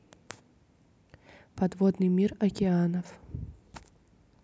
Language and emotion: Russian, neutral